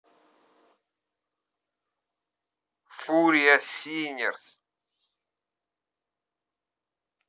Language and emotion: Russian, angry